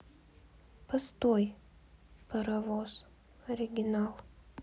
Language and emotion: Russian, sad